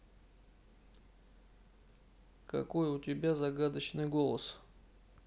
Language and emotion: Russian, neutral